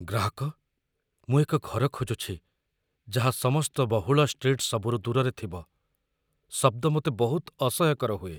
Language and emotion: Odia, fearful